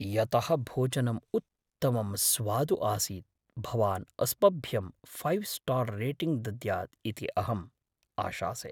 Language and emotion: Sanskrit, fearful